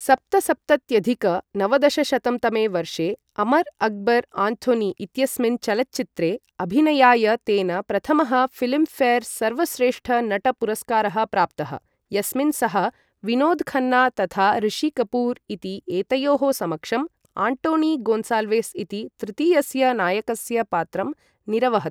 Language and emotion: Sanskrit, neutral